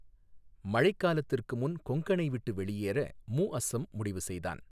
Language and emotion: Tamil, neutral